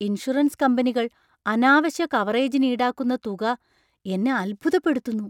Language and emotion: Malayalam, surprised